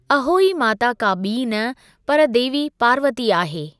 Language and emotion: Sindhi, neutral